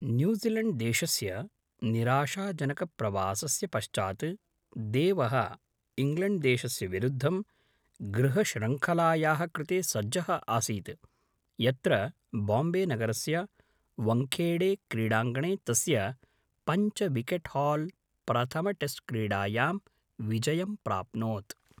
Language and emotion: Sanskrit, neutral